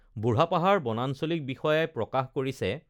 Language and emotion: Assamese, neutral